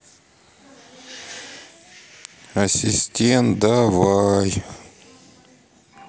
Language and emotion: Russian, sad